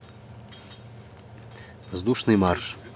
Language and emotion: Russian, neutral